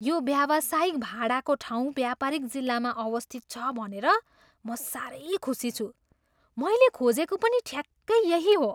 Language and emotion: Nepali, surprised